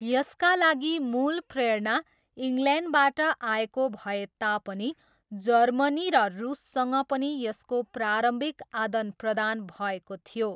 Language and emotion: Nepali, neutral